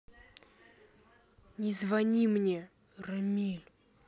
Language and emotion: Russian, angry